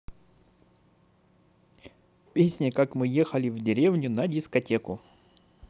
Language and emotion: Russian, positive